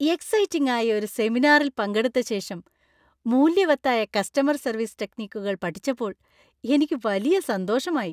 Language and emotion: Malayalam, happy